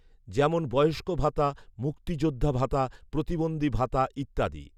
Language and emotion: Bengali, neutral